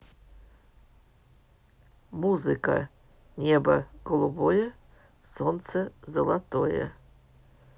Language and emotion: Russian, neutral